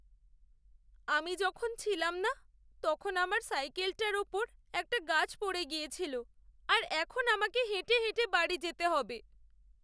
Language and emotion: Bengali, sad